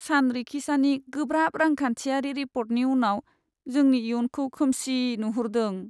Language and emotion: Bodo, sad